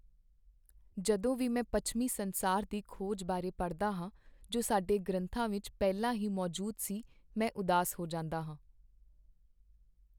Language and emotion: Punjabi, sad